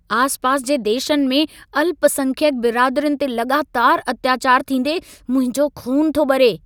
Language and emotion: Sindhi, angry